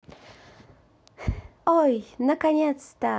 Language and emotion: Russian, positive